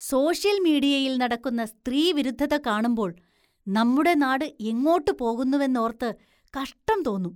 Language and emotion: Malayalam, disgusted